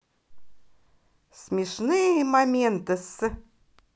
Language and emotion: Russian, positive